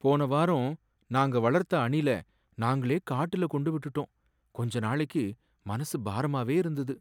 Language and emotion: Tamil, sad